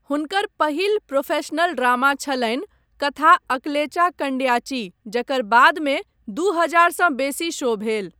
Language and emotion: Maithili, neutral